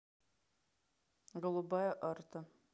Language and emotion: Russian, neutral